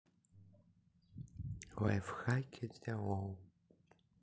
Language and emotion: Russian, neutral